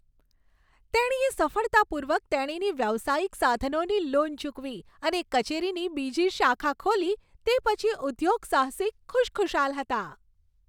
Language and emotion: Gujarati, happy